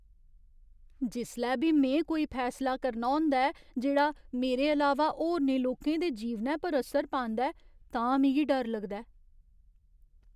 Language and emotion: Dogri, fearful